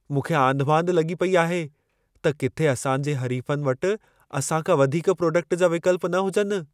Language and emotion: Sindhi, fearful